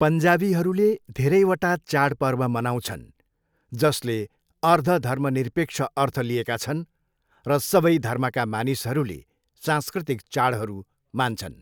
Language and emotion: Nepali, neutral